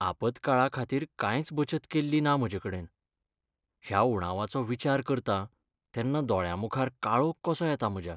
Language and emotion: Goan Konkani, sad